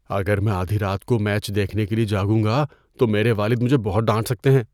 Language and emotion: Urdu, fearful